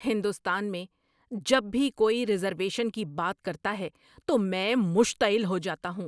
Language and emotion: Urdu, angry